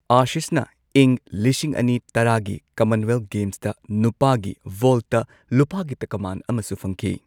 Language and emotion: Manipuri, neutral